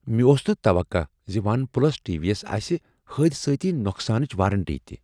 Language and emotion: Kashmiri, surprised